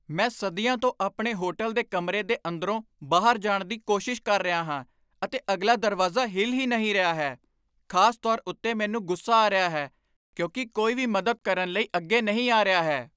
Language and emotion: Punjabi, angry